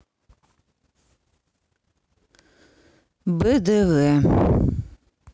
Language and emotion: Russian, neutral